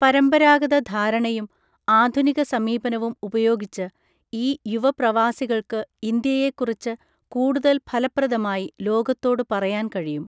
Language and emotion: Malayalam, neutral